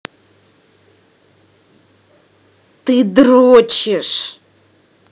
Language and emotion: Russian, angry